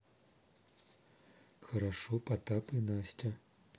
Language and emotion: Russian, neutral